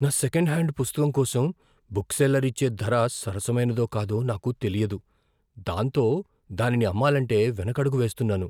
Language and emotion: Telugu, fearful